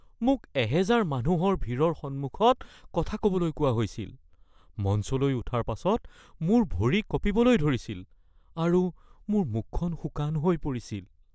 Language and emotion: Assamese, fearful